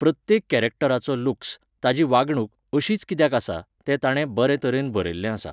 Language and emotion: Goan Konkani, neutral